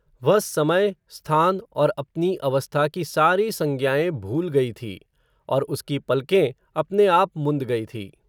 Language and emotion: Hindi, neutral